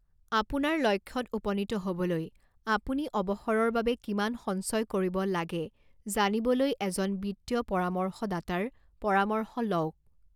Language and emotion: Assamese, neutral